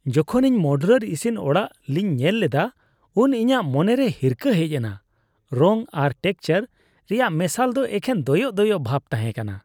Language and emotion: Santali, disgusted